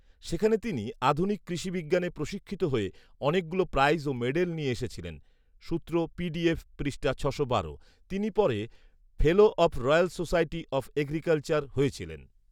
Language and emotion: Bengali, neutral